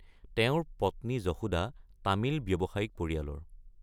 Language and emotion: Assamese, neutral